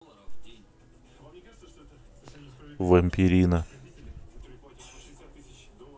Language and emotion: Russian, neutral